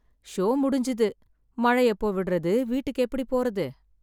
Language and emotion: Tamil, sad